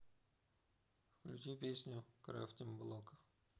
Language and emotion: Russian, neutral